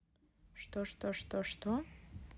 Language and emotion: Russian, neutral